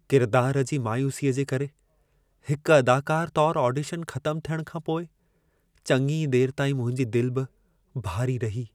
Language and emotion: Sindhi, sad